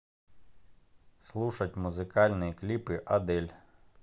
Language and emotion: Russian, neutral